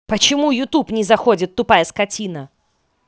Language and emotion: Russian, angry